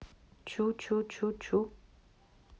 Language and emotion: Russian, neutral